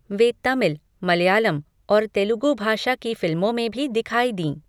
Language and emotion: Hindi, neutral